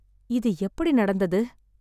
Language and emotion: Tamil, sad